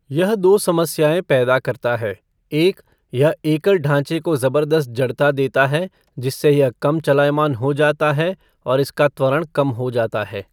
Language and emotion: Hindi, neutral